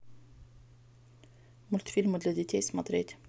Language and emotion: Russian, neutral